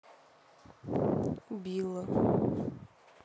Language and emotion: Russian, sad